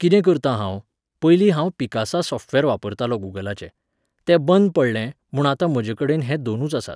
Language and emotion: Goan Konkani, neutral